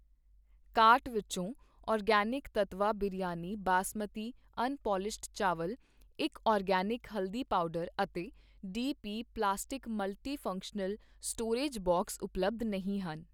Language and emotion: Punjabi, neutral